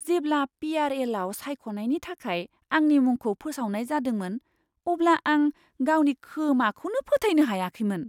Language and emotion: Bodo, surprised